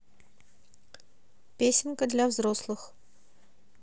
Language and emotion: Russian, neutral